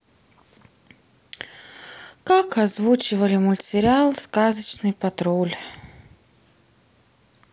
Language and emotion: Russian, sad